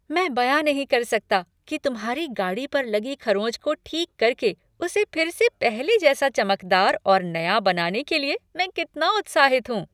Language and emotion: Hindi, happy